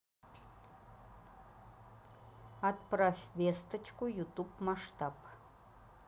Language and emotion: Russian, neutral